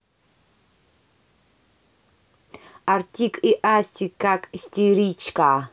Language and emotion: Russian, neutral